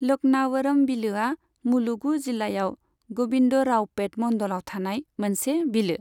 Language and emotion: Bodo, neutral